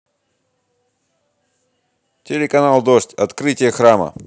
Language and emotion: Russian, positive